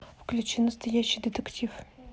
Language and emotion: Russian, neutral